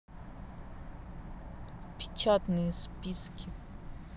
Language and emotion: Russian, neutral